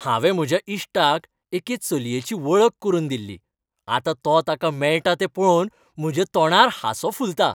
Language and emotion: Goan Konkani, happy